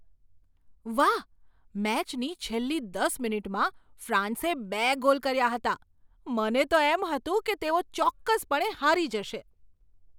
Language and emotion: Gujarati, surprised